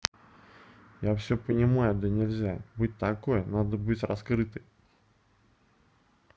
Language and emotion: Russian, neutral